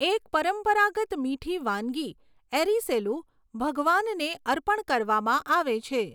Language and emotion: Gujarati, neutral